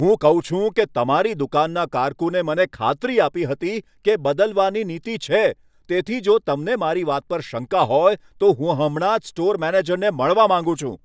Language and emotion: Gujarati, angry